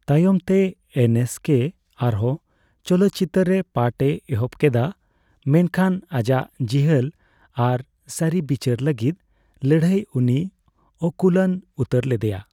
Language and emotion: Santali, neutral